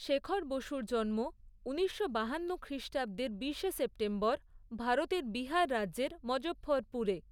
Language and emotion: Bengali, neutral